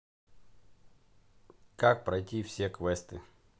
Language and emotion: Russian, neutral